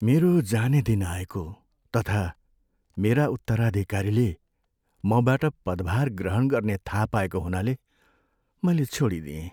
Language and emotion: Nepali, sad